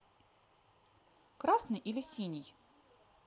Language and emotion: Russian, neutral